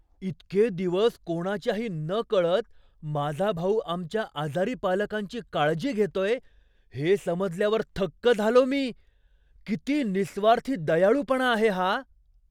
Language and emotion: Marathi, surprised